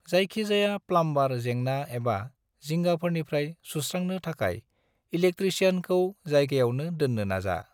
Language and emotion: Bodo, neutral